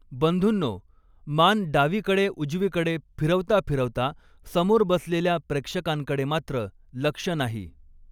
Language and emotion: Marathi, neutral